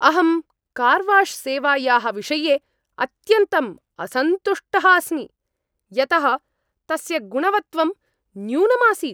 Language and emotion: Sanskrit, angry